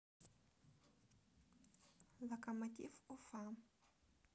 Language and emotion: Russian, neutral